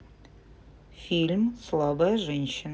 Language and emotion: Russian, neutral